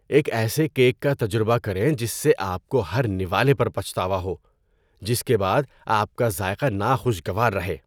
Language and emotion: Urdu, disgusted